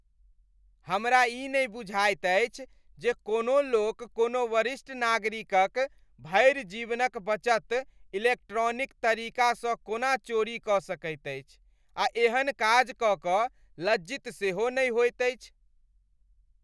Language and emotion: Maithili, disgusted